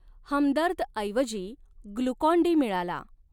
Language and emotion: Marathi, neutral